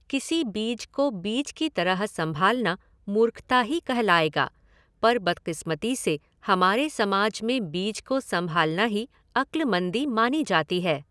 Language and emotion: Hindi, neutral